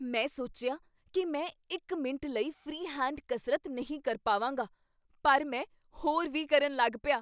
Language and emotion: Punjabi, surprised